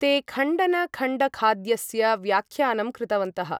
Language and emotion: Sanskrit, neutral